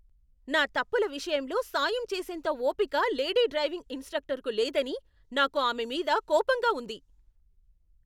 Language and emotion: Telugu, angry